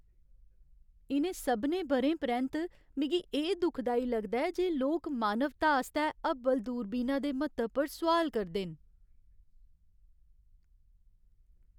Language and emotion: Dogri, sad